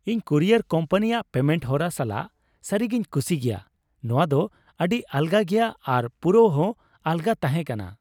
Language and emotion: Santali, happy